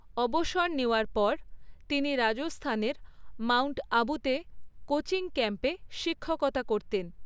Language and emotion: Bengali, neutral